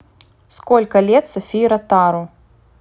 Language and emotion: Russian, neutral